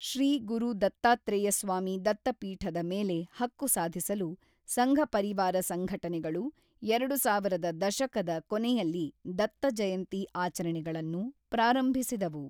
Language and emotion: Kannada, neutral